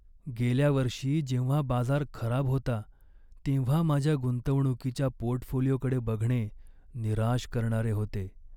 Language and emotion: Marathi, sad